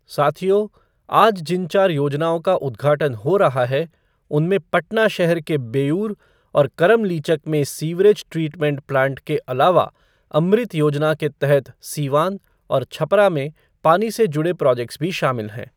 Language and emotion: Hindi, neutral